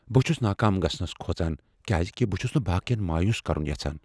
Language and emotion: Kashmiri, fearful